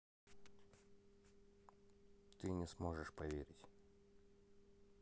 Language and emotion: Russian, neutral